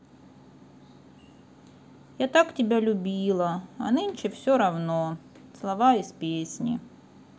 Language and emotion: Russian, sad